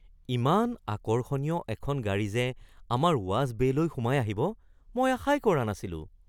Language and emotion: Assamese, surprised